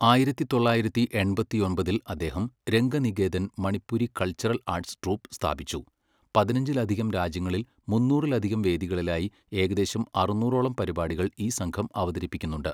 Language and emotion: Malayalam, neutral